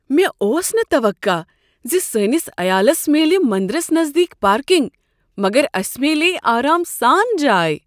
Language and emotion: Kashmiri, surprised